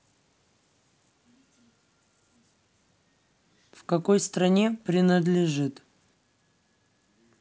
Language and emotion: Russian, neutral